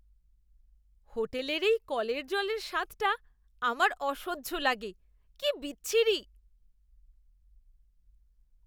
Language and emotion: Bengali, disgusted